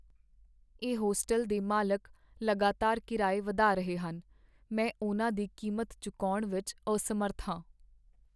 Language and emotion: Punjabi, sad